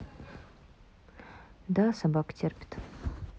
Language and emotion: Russian, neutral